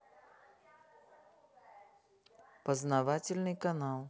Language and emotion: Russian, neutral